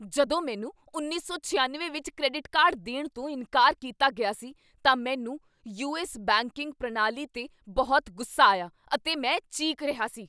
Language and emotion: Punjabi, angry